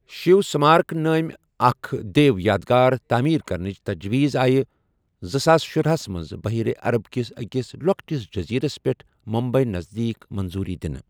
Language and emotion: Kashmiri, neutral